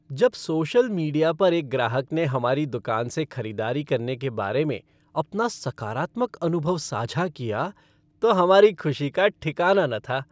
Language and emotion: Hindi, happy